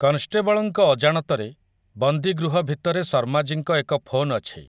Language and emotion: Odia, neutral